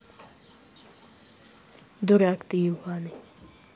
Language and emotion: Russian, angry